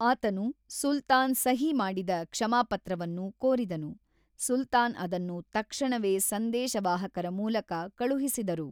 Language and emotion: Kannada, neutral